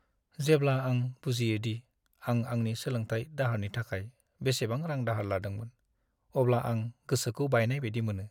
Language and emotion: Bodo, sad